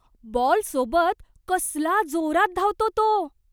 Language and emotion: Marathi, surprised